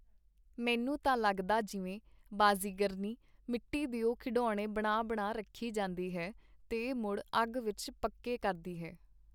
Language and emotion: Punjabi, neutral